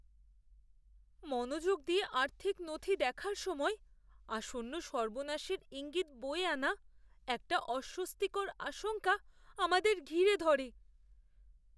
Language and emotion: Bengali, fearful